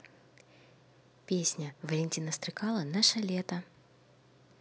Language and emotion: Russian, neutral